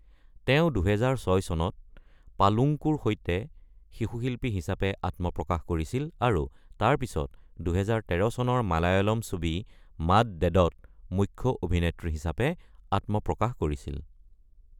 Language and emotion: Assamese, neutral